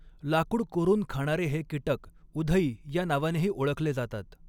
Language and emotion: Marathi, neutral